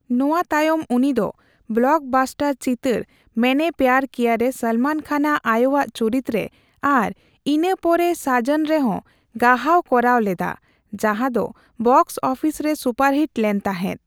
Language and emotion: Santali, neutral